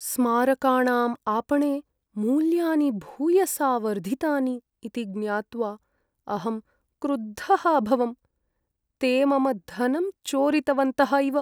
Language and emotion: Sanskrit, sad